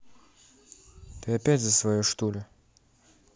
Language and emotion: Russian, neutral